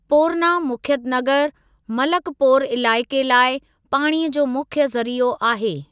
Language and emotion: Sindhi, neutral